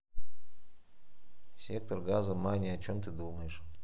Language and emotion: Russian, neutral